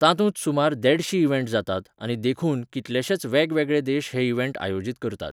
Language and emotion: Goan Konkani, neutral